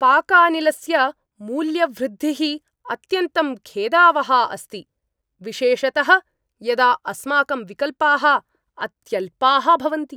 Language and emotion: Sanskrit, angry